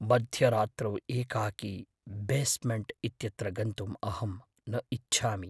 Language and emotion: Sanskrit, fearful